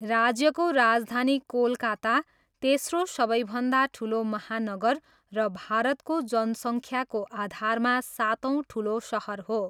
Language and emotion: Nepali, neutral